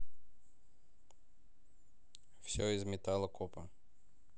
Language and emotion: Russian, neutral